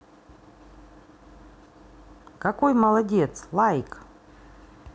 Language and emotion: Russian, positive